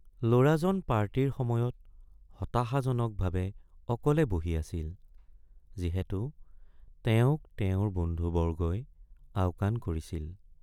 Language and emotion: Assamese, sad